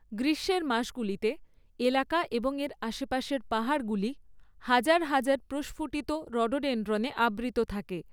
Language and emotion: Bengali, neutral